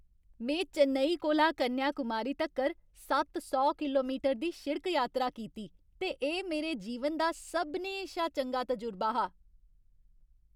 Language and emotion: Dogri, happy